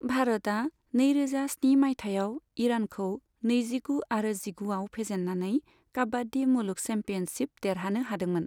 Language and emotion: Bodo, neutral